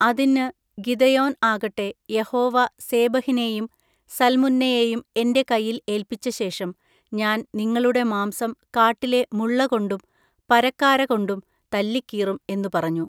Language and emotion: Malayalam, neutral